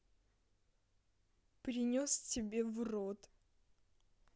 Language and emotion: Russian, angry